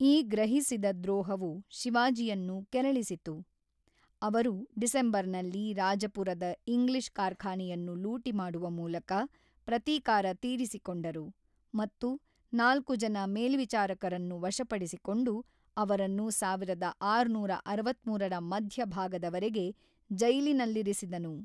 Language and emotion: Kannada, neutral